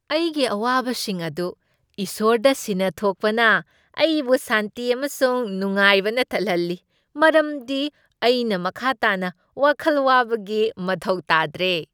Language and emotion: Manipuri, happy